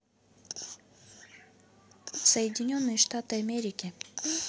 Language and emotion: Russian, neutral